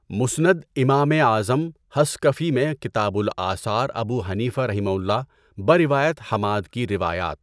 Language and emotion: Urdu, neutral